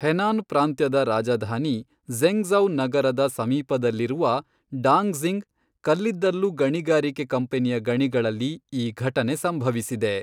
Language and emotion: Kannada, neutral